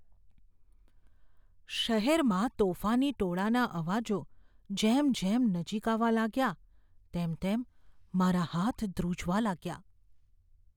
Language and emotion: Gujarati, fearful